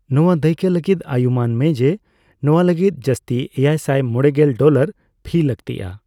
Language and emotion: Santali, neutral